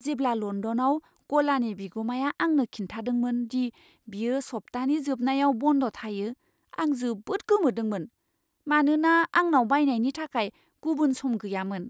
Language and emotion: Bodo, surprised